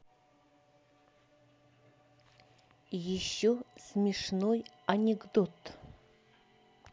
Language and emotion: Russian, neutral